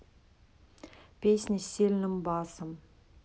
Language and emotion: Russian, neutral